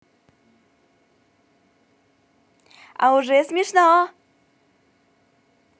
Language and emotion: Russian, positive